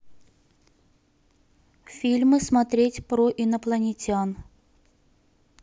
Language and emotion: Russian, neutral